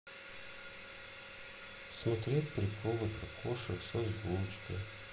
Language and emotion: Russian, sad